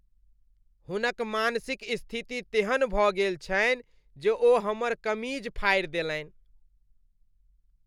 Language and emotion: Maithili, disgusted